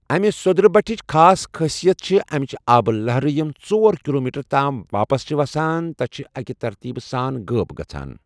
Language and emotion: Kashmiri, neutral